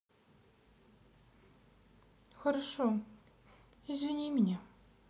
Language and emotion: Russian, sad